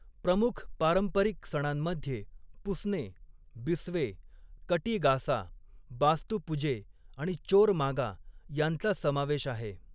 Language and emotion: Marathi, neutral